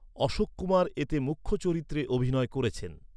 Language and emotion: Bengali, neutral